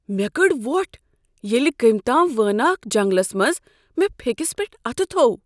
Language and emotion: Kashmiri, surprised